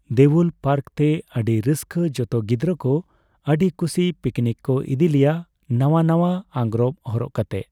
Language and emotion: Santali, neutral